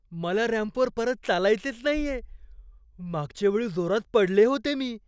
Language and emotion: Marathi, fearful